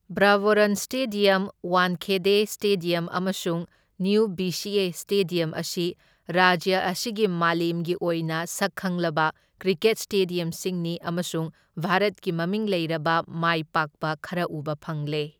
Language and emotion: Manipuri, neutral